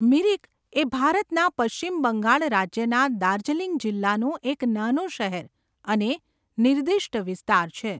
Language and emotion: Gujarati, neutral